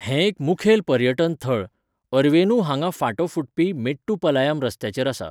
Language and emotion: Goan Konkani, neutral